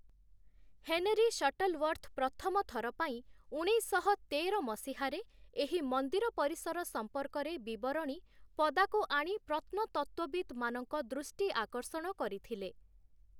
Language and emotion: Odia, neutral